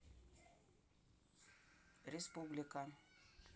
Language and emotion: Russian, neutral